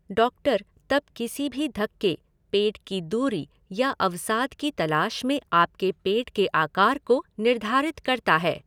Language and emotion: Hindi, neutral